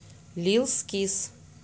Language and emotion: Russian, neutral